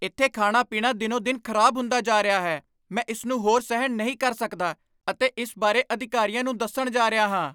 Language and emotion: Punjabi, angry